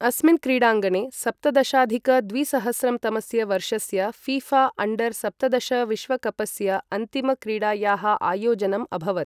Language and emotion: Sanskrit, neutral